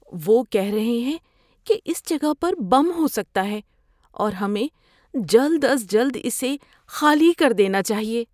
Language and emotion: Urdu, fearful